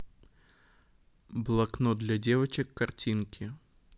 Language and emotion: Russian, neutral